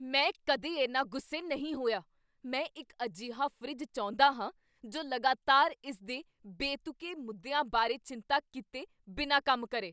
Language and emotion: Punjabi, angry